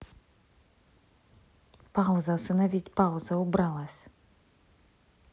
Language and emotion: Russian, angry